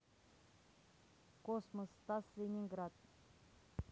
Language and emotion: Russian, neutral